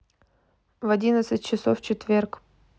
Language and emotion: Russian, neutral